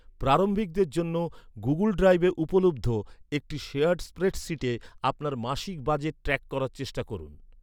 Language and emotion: Bengali, neutral